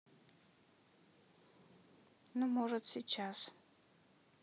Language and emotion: Russian, neutral